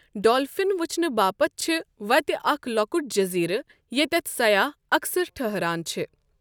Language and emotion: Kashmiri, neutral